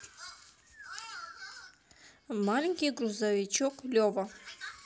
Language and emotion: Russian, neutral